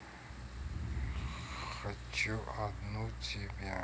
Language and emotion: Russian, sad